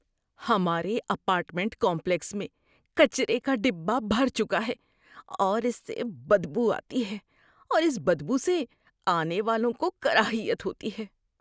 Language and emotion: Urdu, disgusted